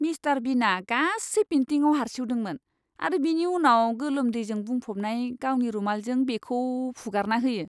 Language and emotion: Bodo, disgusted